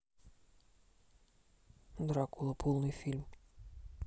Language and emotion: Russian, neutral